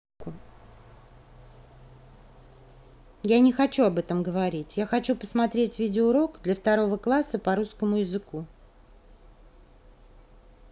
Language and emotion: Russian, neutral